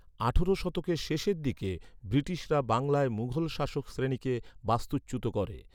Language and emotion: Bengali, neutral